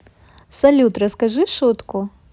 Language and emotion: Russian, positive